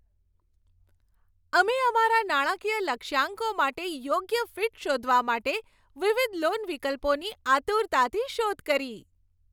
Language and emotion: Gujarati, happy